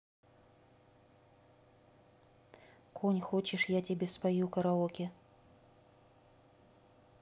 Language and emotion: Russian, neutral